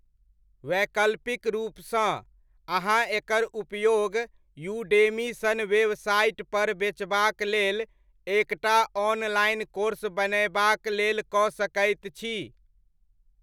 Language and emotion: Maithili, neutral